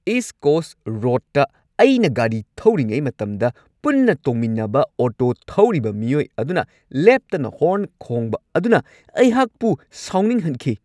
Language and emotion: Manipuri, angry